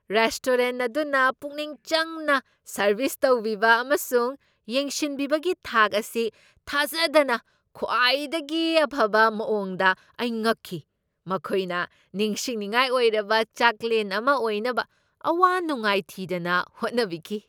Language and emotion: Manipuri, surprised